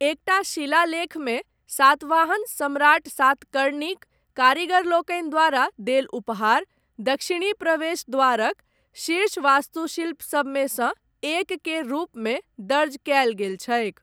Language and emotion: Maithili, neutral